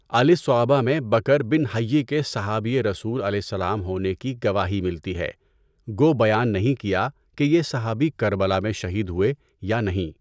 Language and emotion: Urdu, neutral